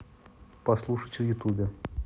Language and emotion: Russian, neutral